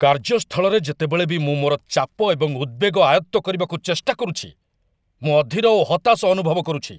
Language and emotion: Odia, angry